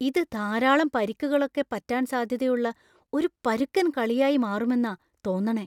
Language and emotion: Malayalam, fearful